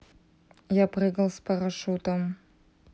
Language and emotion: Russian, neutral